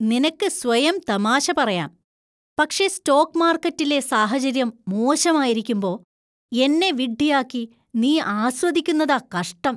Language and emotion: Malayalam, disgusted